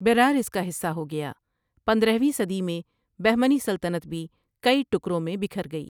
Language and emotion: Urdu, neutral